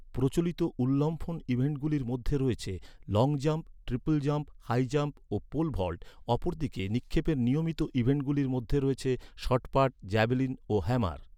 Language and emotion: Bengali, neutral